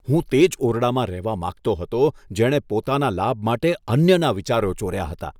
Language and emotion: Gujarati, disgusted